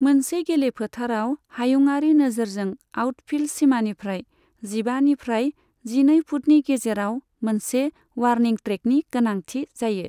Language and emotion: Bodo, neutral